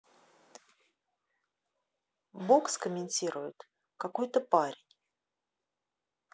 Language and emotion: Russian, neutral